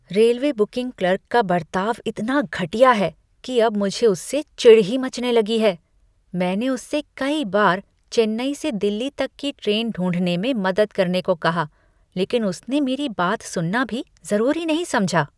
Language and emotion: Hindi, disgusted